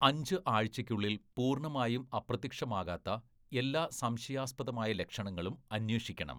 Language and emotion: Malayalam, neutral